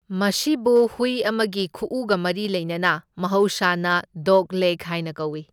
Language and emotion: Manipuri, neutral